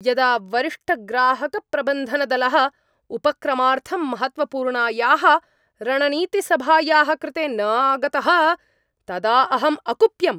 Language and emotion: Sanskrit, angry